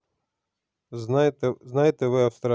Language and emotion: Russian, neutral